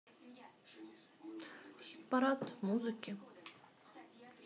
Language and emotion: Russian, neutral